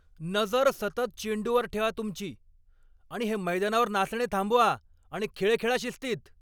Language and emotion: Marathi, angry